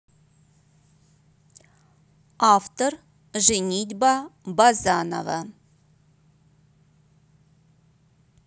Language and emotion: Russian, neutral